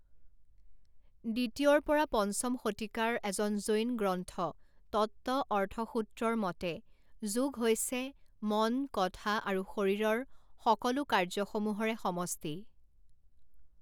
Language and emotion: Assamese, neutral